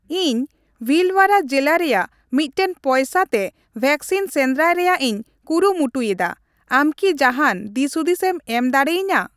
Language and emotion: Santali, neutral